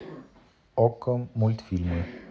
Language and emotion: Russian, neutral